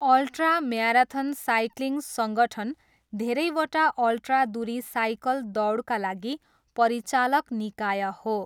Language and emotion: Nepali, neutral